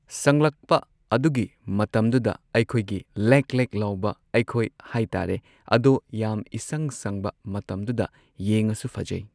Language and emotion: Manipuri, neutral